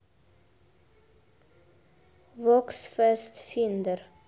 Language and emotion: Russian, neutral